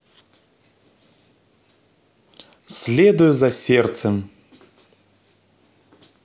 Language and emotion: Russian, positive